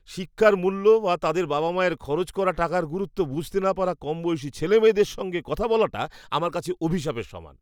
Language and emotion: Bengali, disgusted